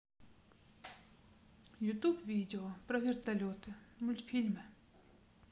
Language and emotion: Russian, neutral